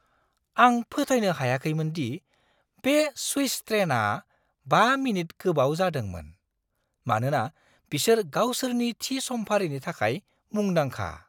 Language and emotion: Bodo, surprised